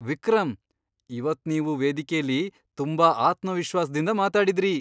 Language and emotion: Kannada, surprised